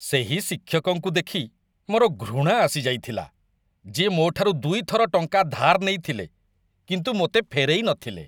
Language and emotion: Odia, disgusted